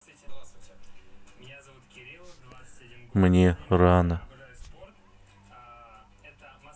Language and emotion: Russian, sad